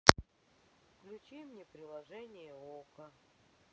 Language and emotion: Russian, sad